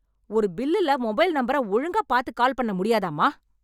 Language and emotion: Tamil, angry